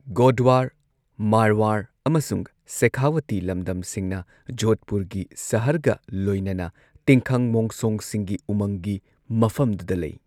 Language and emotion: Manipuri, neutral